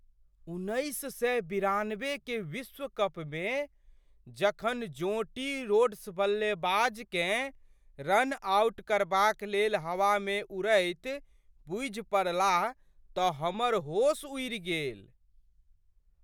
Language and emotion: Maithili, surprised